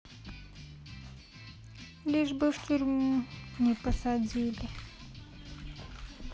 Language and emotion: Russian, sad